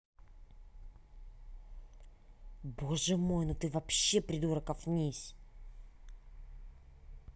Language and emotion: Russian, angry